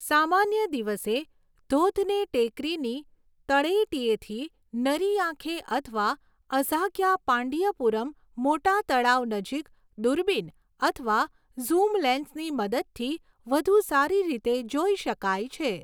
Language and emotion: Gujarati, neutral